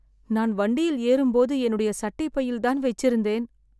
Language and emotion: Tamil, sad